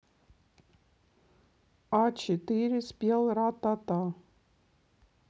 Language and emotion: Russian, neutral